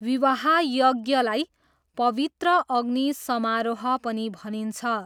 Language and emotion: Nepali, neutral